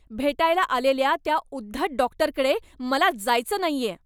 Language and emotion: Marathi, angry